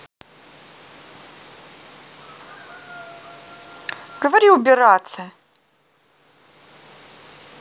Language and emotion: Russian, angry